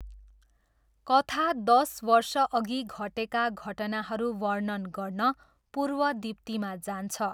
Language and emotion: Nepali, neutral